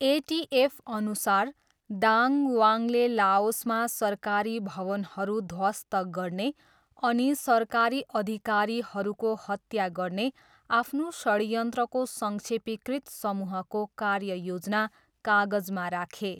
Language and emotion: Nepali, neutral